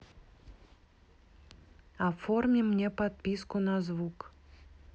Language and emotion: Russian, neutral